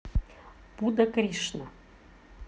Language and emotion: Russian, neutral